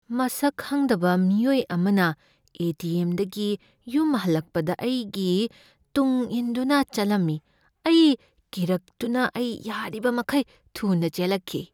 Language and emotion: Manipuri, fearful